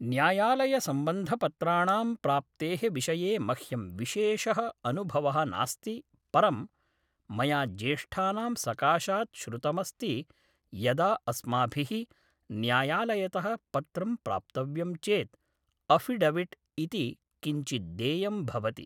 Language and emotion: Sanskrit, neutral